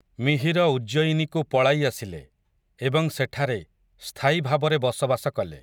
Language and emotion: Odia, neutral